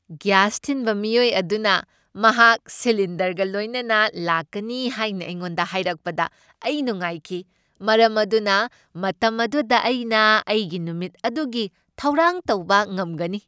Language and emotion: Manipuri, happy